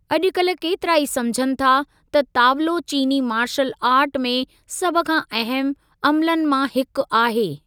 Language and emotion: Sindhi, neutral